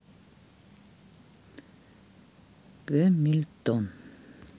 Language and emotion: Russian, sad